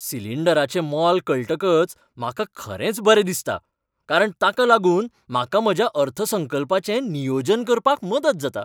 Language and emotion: Goan Konkani, happy